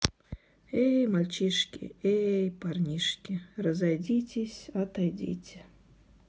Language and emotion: Russian, sad